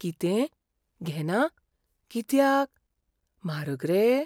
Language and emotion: Goan Konkani, fearful